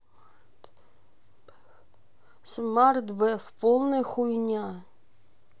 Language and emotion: Russian, neutral